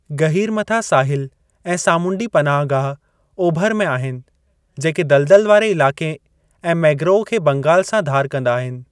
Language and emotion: Sindhi, neutral